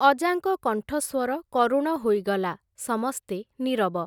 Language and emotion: Odia, neutral